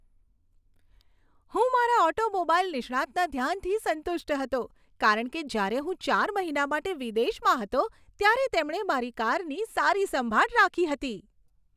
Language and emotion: Gujarati, happy